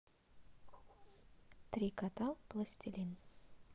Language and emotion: Russian, neutral